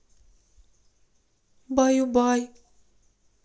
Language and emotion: Russian, sad